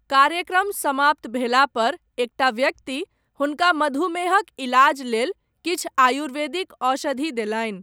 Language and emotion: Maithili, neutral